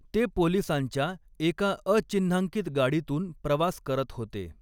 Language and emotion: Marathi, neutral